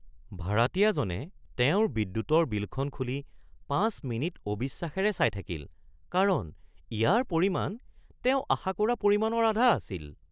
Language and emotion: Assamese, surprised